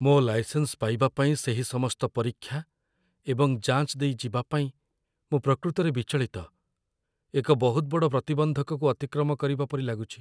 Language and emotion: Odia, fearful